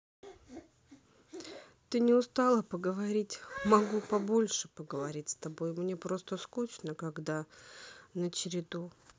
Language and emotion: Russian, sad